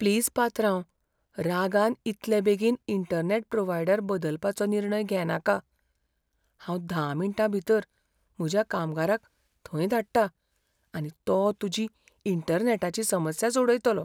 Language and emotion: Goan Konkani, fearful